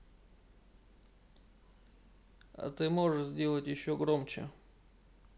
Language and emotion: Russian, neutral